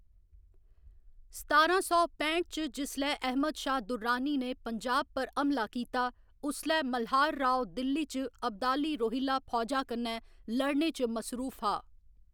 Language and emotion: Dogri, neutral